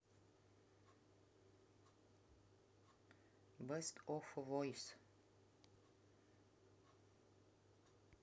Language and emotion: Russian, neutral